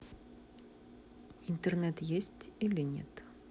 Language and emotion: Russian, neutral